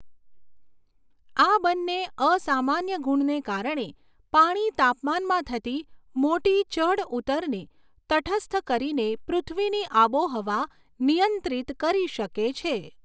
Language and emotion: Gujarati, neutral